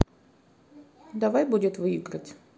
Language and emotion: Russian, neutral